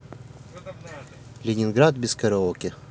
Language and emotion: Russian, neutral